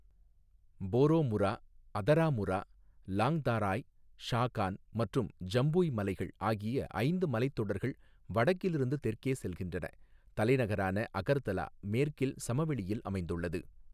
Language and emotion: Tamil, neutral